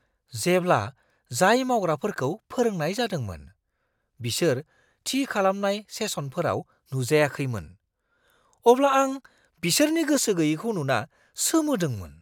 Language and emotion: Bodo, surprised